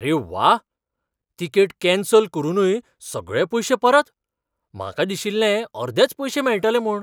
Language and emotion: Goan Konkani, surprised